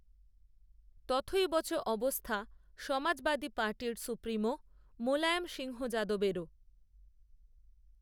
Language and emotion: Bengali, neutral